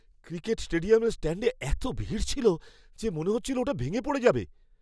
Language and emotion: Bengali, fearful